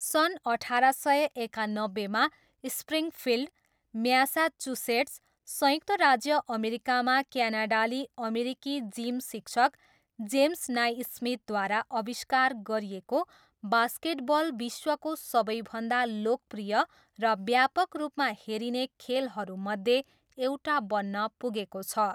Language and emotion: Nepali, neutral